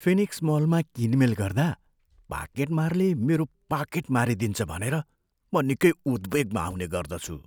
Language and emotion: Nepali, fearful